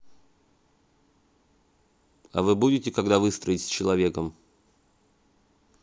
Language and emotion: Russian, neutral